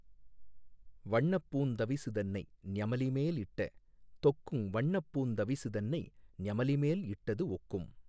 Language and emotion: Tamil, neutral